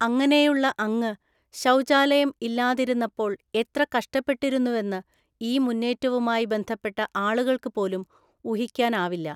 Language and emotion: Malayalam, neutral